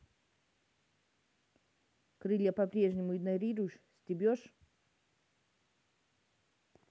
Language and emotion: Russian, angry